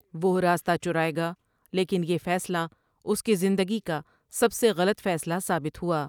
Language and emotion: Urdu, neutral